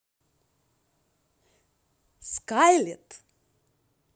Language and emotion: Russian, positive